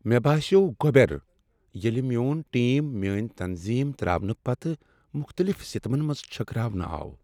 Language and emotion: Kashmiri, sad